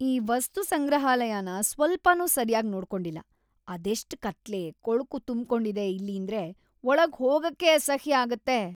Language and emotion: Kannada, disgusted